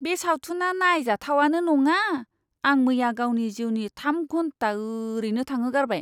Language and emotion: Bodo, disgusted